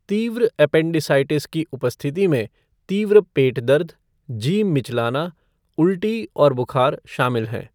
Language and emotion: Hindi, neutral